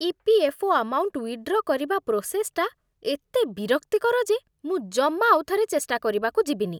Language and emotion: Odia, disgusted